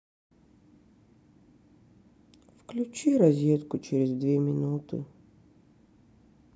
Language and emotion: Russian, sad